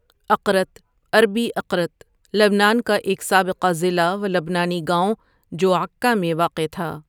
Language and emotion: Urdu, neutral